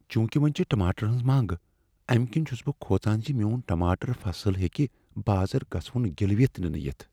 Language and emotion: Kashmiri, fearful